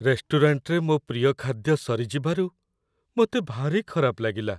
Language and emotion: Odia, sad